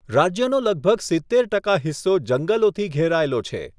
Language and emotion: Gujarati, neutral